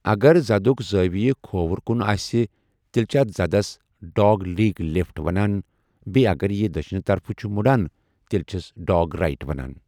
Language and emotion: Kashmiri, neutral